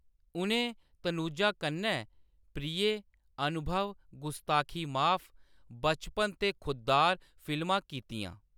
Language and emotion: Dogri, neutral